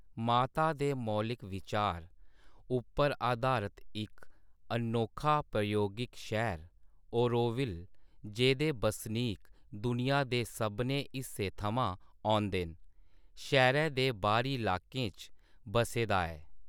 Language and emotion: Dogri, neutral